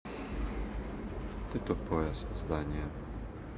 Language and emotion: Russian, neutral